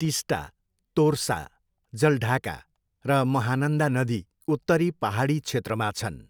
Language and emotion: Nepali, neutral